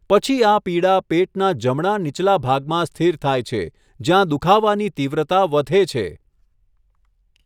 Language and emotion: Gujarati, neutral